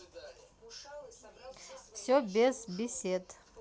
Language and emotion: Russian, neutral